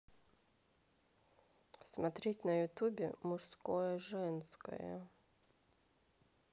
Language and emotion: Russian, neutral